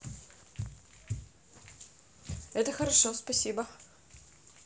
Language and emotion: Russian, positive